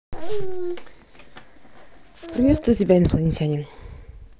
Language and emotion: Russian, neutral